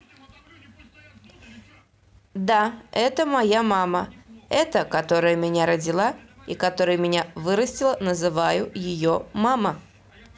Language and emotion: Russian, neutral